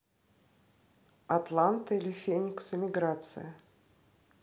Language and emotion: Russian, neutral